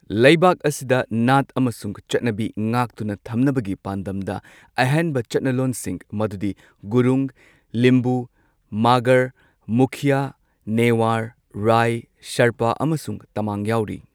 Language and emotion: Manipuri, neutral